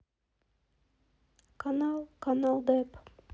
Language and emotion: Russian, sad